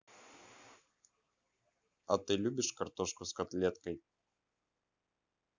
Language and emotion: Russian, neutral